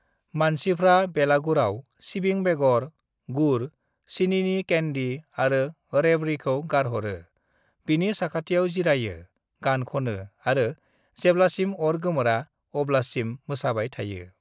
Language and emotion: Bodo, neutral